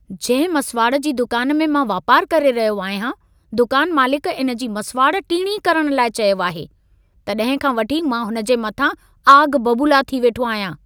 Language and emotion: Sindhi, angry